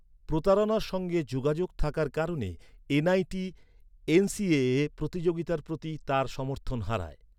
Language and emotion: Bengali, neutral